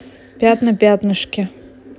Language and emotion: Russian, neutral